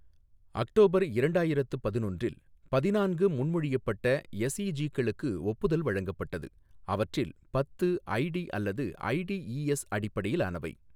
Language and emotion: Tamil, neutral